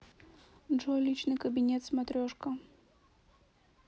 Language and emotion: Russian, neutral